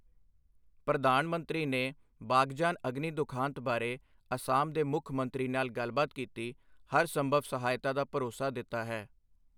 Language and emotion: Punjabi, neutral